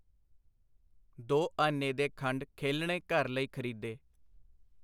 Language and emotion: Punjabi, neutral